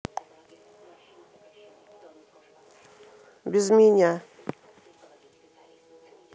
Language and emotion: Russian, neutral